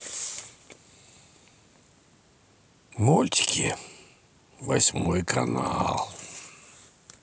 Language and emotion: Russian, sad